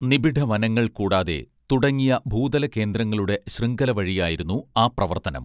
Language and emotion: Malayalam, neutral